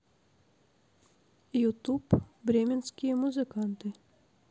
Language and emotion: Russian, neutral